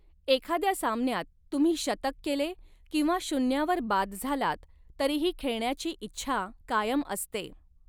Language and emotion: Marathi, neutral